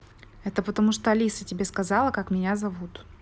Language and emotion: Russian, neutral